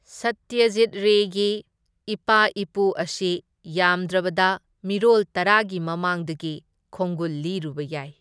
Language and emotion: Manipuri, neutral